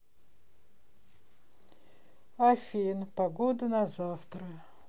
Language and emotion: Russian, sad